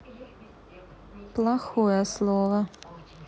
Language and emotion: Russian, neutral